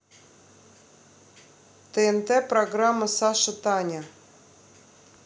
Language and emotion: Russian, neutral